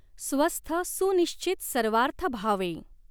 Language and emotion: Marathi, neutral